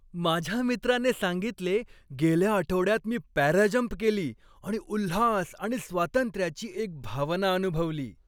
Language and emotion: Marathi, happy